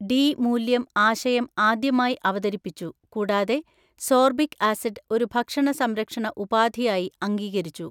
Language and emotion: Malayalam, neutral